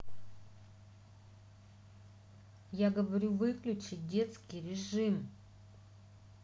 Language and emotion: Russian, angry